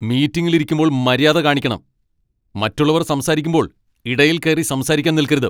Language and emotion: Malayalam, angry